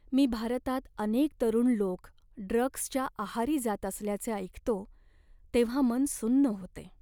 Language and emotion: Marathi, sad